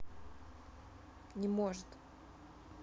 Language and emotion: Russian, neutral